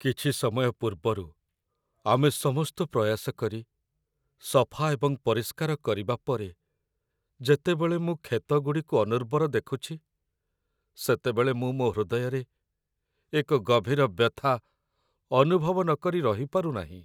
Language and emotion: Odia, sad